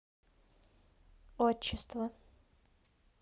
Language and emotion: Russian, neutral